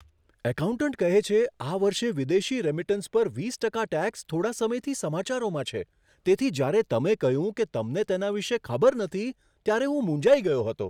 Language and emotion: Gujarati, surprised